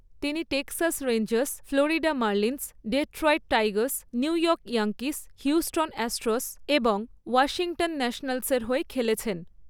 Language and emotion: Bengali, neutral